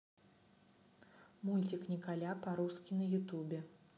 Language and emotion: Russian, neutral